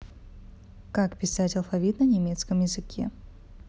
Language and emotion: Russian, neutral